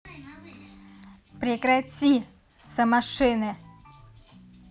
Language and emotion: Russian, angry